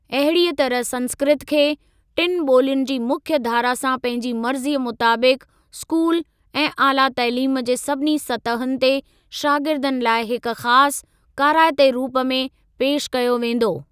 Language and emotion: Sindhi, neutral